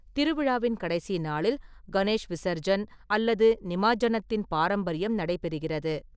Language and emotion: Tamil, neutral